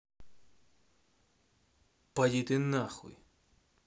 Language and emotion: Russian, angry